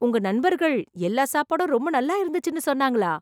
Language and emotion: Tamil, surprised